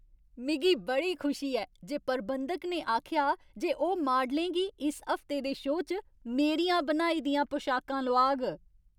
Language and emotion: Dogri, happy